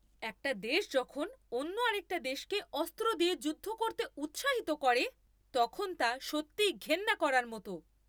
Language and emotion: Bengali, angry